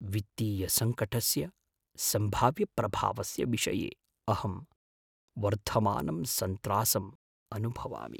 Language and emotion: Sanskrit, fearful